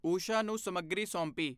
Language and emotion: Punjabi, neutral